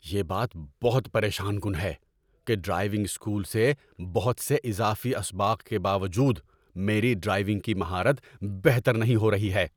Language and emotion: Urdu, angry